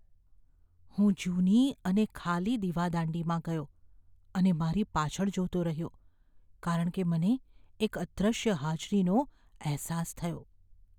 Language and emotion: Gujarati, fearful